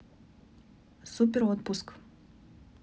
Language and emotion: Russian, neutral